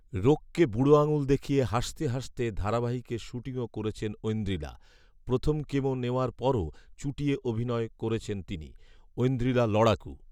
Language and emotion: Bengali, neutral